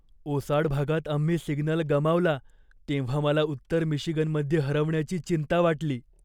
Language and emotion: Marathi, fearful